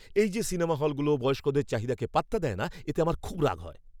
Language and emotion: Bengali, angry